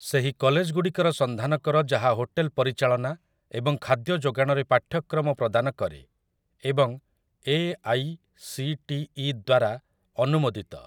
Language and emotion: Odia, neutral